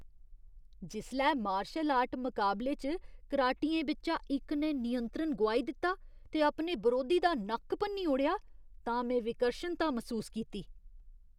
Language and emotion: Dogri, disgusted